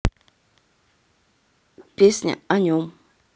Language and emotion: Russian, neutral